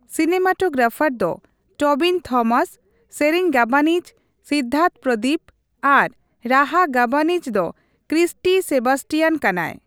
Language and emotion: Santali, neutral